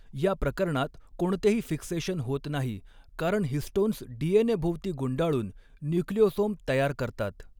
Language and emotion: Marathi, neutral